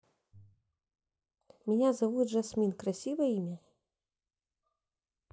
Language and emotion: Russian, neutral